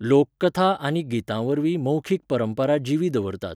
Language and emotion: Goan Konkani, neutral